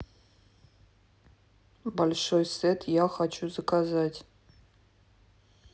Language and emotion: Russian, neutral